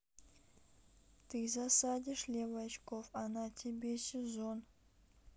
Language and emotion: Russian, neutral